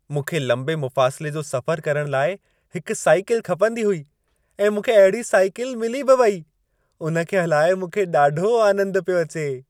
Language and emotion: Sindhi, happy